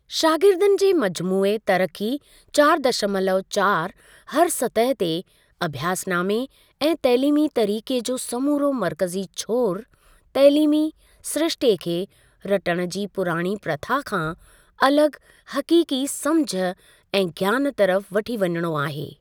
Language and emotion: Sindhi, neutral